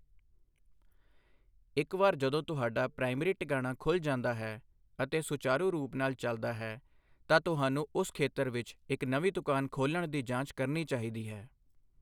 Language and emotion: Punjabi, neutral